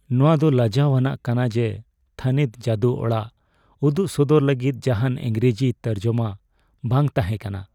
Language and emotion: Santali, sad